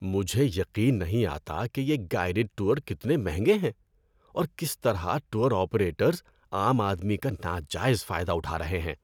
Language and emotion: Urdu, disgusted